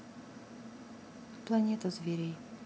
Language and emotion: Russian, neutral